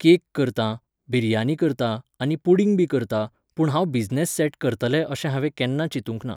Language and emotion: Goan Konkani, neutral